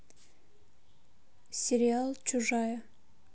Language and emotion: Russian, neutral